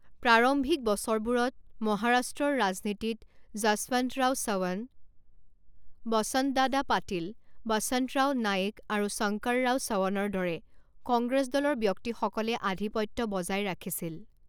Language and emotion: Assamese, neutral